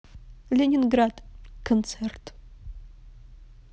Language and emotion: Russian, neutral